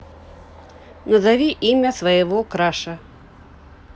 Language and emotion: Russian, neutral